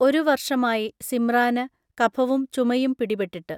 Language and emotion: Malayalam, neutral